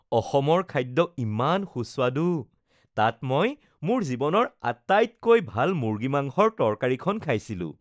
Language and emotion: Assamese, happy